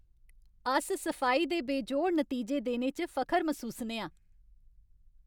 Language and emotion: Dogri, happy